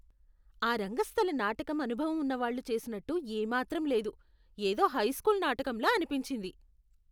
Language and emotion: Telugu, disgusted